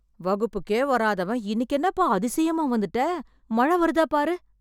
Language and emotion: Tamil, surprised